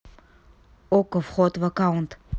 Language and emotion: Russian, neutral